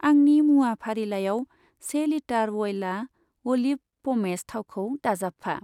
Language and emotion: Bodo, neutral